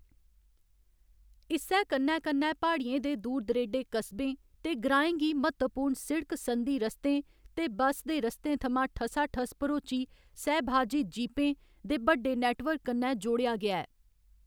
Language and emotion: Dogri, neutral